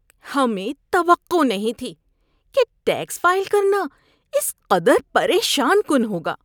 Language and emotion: Urdu, disgusted